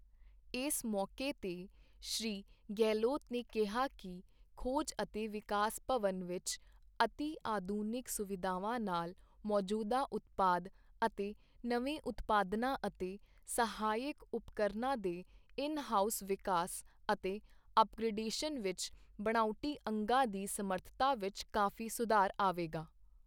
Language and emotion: Punjabi, neutral